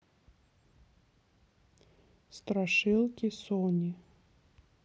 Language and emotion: Russian, neutral